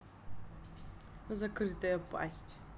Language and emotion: Russian, neutral